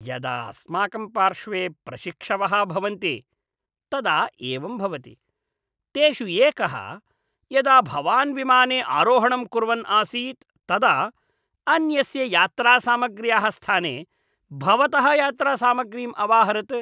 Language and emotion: Sanskrit, disgusted